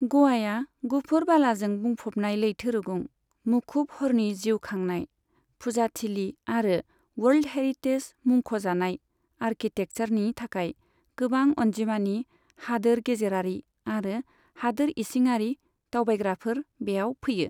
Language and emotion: Bodo, neutral